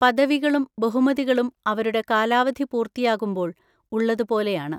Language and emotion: Malayalam, neutral